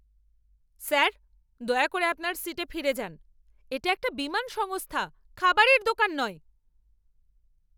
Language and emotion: Bengali, angry